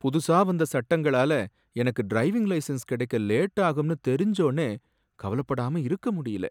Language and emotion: Tamil, sad